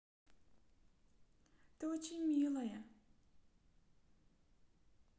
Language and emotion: Russian, positive